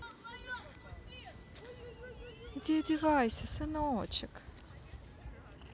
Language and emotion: Russian, neutral